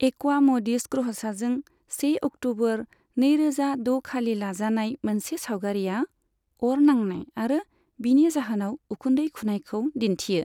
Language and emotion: Bodo, neutral